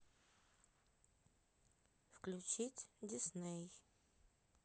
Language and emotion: Russian, neutral